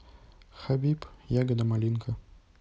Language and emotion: Russian, neutral